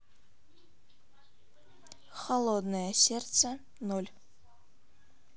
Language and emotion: Russian, neutral